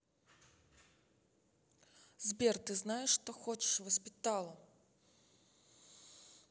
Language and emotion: Russian, angry